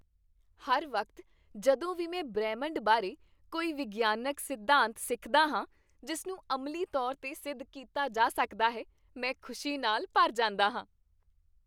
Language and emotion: Punjabi, happy